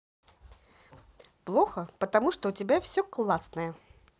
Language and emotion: Russian, positive